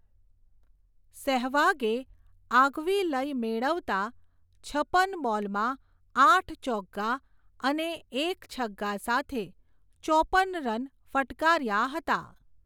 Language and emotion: Gujarati, neutral